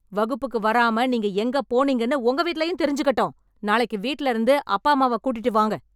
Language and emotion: Tamil, angry